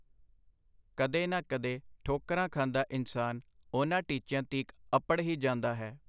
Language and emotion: Punjabi, neutral